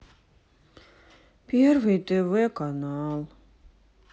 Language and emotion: Russian, sad